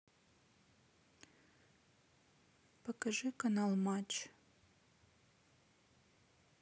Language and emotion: Russian, neutral